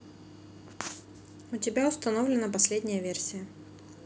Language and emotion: Russian, neutral